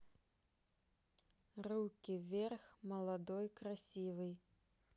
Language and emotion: Russian, neutral